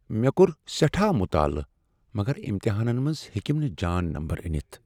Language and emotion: Kashmiri, sad